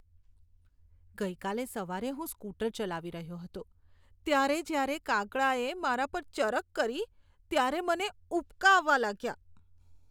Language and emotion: Gujarati, disgusted